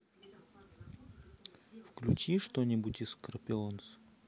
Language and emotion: Russian, neutral